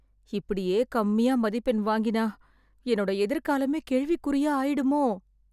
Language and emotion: Tamil, fearful